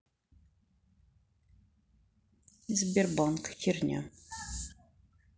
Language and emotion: Russian, neutral